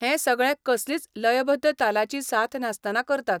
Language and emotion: Goan Konkani, neutral